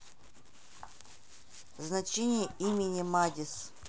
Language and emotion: Russian, neutral